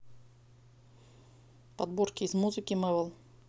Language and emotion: Russian, neutral